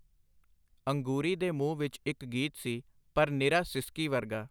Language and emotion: Punjabi, neutral